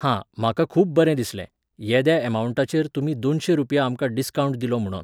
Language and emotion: Goan Konkani, neutral